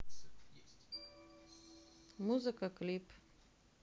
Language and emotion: Russian, neutral